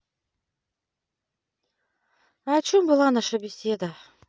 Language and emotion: Russian, sad